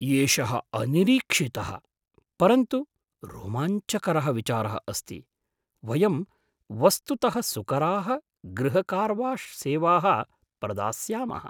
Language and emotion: Sanskrit, surprised